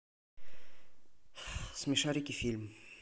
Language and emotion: Russian, neutral